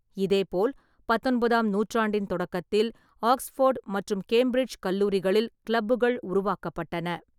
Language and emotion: Tamil, neutral